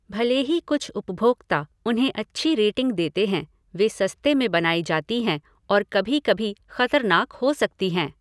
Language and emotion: Hindi, neutral